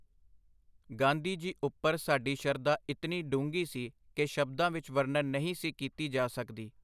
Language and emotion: Punjabi, neutral